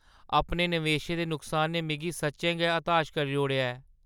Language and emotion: Dogri, sad